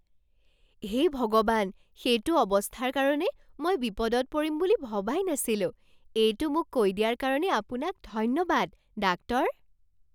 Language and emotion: Assamese, surprised